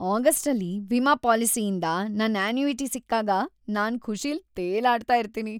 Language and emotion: Kannada, happy